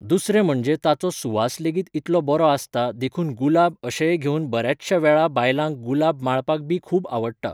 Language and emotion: Goan Konkani, neutral